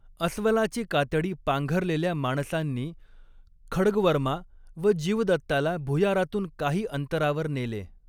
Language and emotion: Marathi, neutral